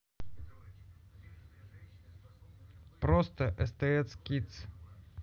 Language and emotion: Russian, neutral